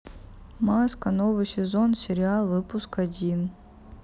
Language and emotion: Russian, neutral